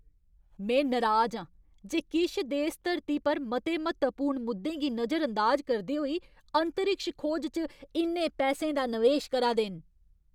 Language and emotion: Dogri, angry